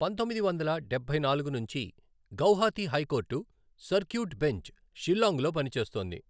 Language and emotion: Telugu, neutral